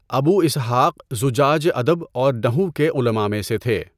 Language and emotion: Urdu, neutral